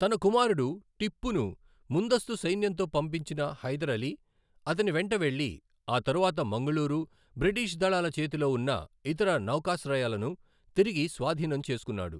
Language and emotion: Telugu, neutral